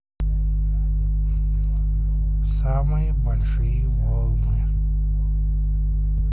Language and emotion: Russian, neutral